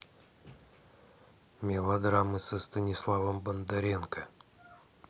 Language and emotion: Russian, neutral